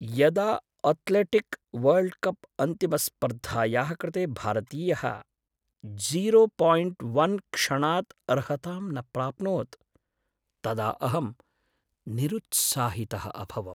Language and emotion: Sanskrit, sad